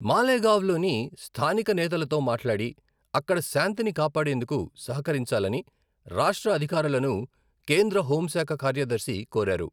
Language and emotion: Telugu, neutral